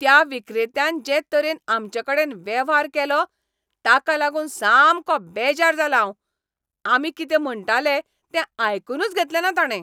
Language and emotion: Goan Konkani, angry